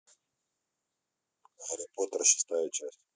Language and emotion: Russian, neutral